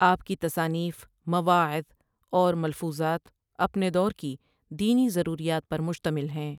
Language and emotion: Urdu, neutral